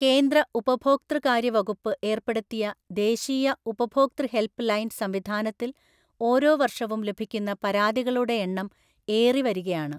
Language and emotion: Malayalam, neutral